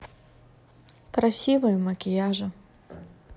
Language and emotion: Russian, neutral